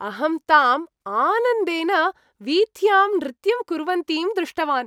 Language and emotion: Sanskrit, happy